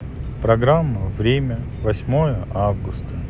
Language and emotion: Russian, sad